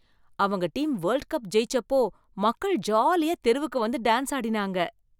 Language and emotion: Tamil, happy